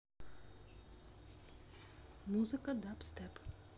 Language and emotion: Russian, neutral